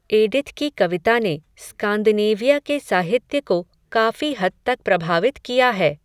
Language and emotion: Hindi, neutral